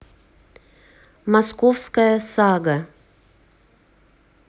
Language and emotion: Russian, neutral